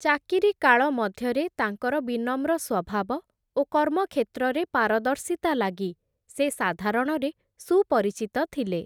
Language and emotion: Odia, neutral